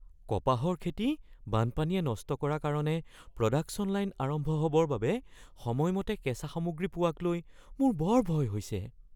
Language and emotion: Assamese, fearful